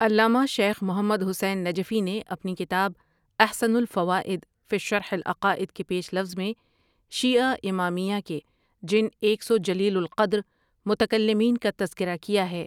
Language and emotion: Urdu, neutral